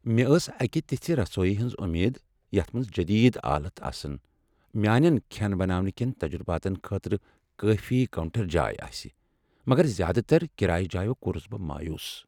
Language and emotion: Kashmiri, sad